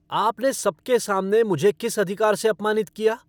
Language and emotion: Hindi, angry